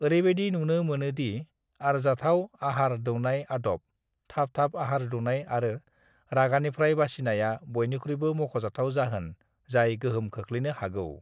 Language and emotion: Bodo, neutral